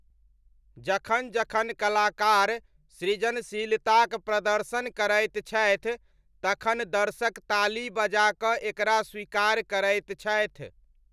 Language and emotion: Maithili, neutral